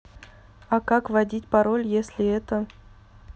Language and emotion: Russian, neutral